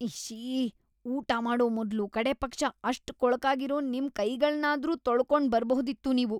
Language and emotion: Kannada, disgusted